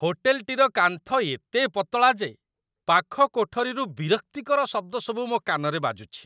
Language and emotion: Odia, disgusted